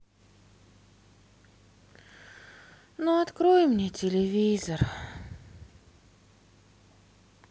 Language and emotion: Russian, sad